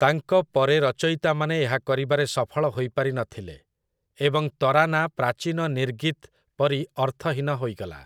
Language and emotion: Odia, neutral